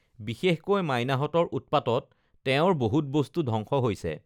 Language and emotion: Assamese, neutral